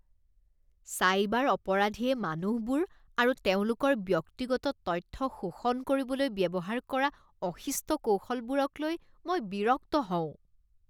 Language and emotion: Assamese, disgusted